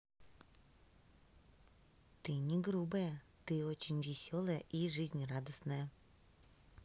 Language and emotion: Russian, neutral